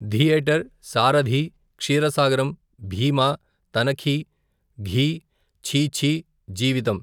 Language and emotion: Telugu, neutral